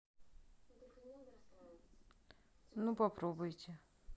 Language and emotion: Russian, neutral